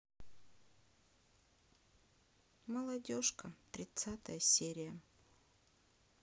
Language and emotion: Russian, sad